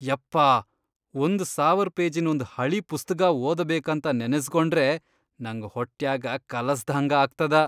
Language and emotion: Kannada, disgusted